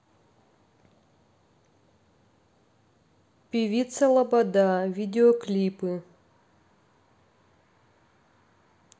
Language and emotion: Russian, neutral